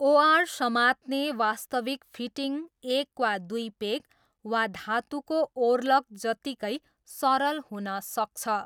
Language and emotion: Nepali, neutral